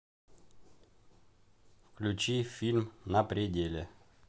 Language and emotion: Russian, neutral